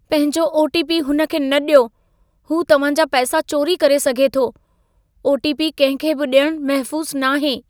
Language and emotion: Sindhi, fearful